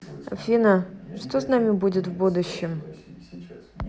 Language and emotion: Russian, neutral